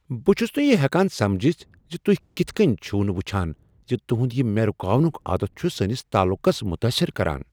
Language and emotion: Kashmiri, surprised